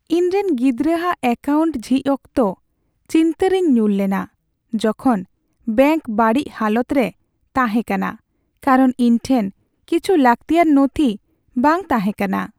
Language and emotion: Santali, sad